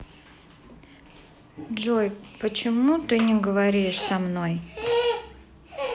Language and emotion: Russian, sad